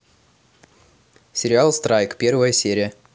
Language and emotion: Russian, neutral